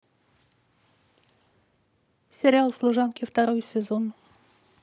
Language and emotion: Russian, neutral